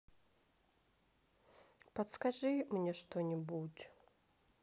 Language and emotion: Russian, sad